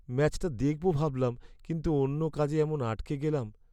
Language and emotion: Bengali, sad